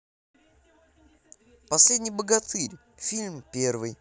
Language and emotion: Russian, positive